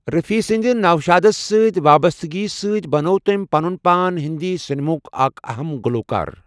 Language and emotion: Kashmiri, neutral